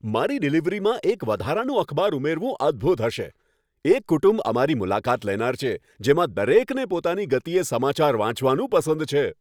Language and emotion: Gujarati, happy